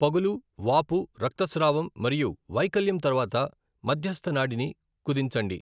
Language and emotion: Telugu, neutral